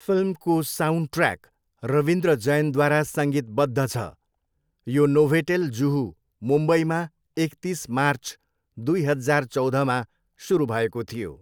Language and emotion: Nepali, neutral